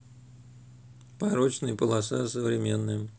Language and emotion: Russian, neutral